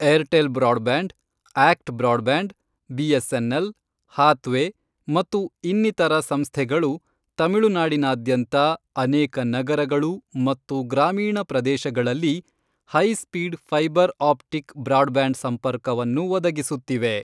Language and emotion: Kannada, neutral